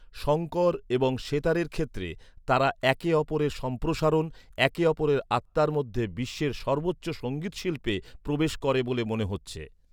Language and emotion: Bengali, neutral